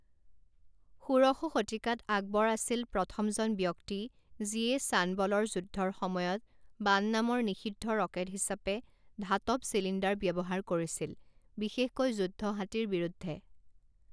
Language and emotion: Assamese, neutral